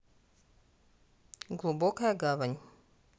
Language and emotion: Russian, neutral